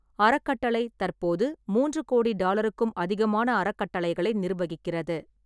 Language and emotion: Tamil, neutral